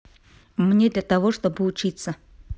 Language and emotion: Russian, neutral